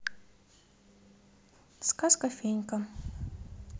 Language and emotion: Russian, neutral